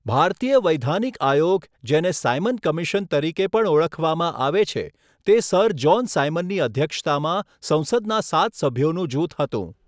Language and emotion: Gujarati, neutral